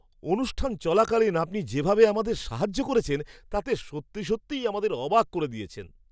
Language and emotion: Bengali, surprised